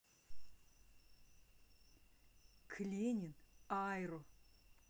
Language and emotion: Russian, neutral